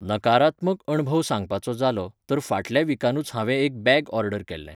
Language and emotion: Goan Konkani, neutral